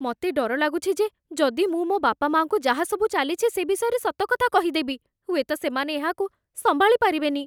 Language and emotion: Odia, fearful